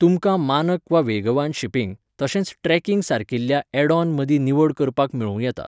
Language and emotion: Goan Konkani, neutral